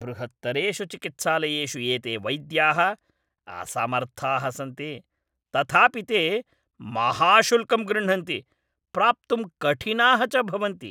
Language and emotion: Sanskrit, angry